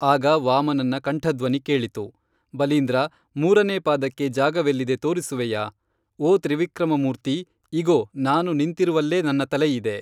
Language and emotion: Kannada, neutral